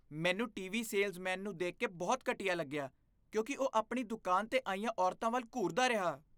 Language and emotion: Punjabi, disgusted